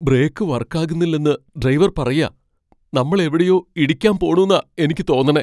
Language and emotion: Malayalam, fearful